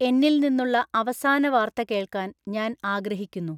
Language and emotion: Malayalam, neutral